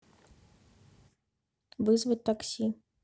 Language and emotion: Russian, neutral